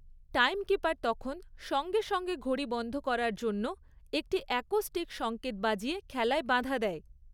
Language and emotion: Bengali, neutral